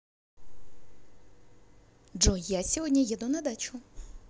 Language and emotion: Russian, positive